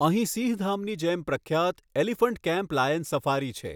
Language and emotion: Gujarati, neutral